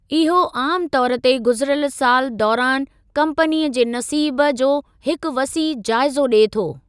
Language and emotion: Sindhi, neutral